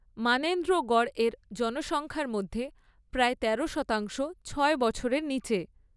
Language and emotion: Bengali, neutral